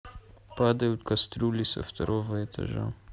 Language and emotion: Russian, neutral